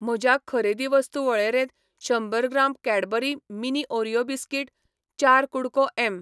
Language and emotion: Goan Konkani, neutral